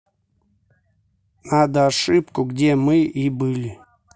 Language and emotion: Russian, neutral